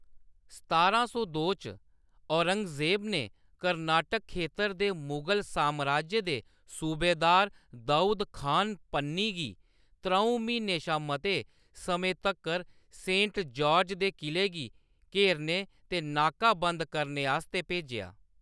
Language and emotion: Dogri, neutral